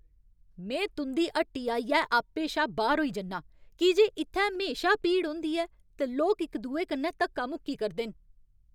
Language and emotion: Dogri, angry